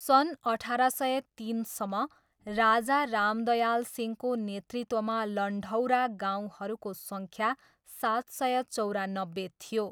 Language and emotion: Nepali, neutral